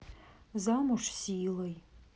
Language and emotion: Russian, sad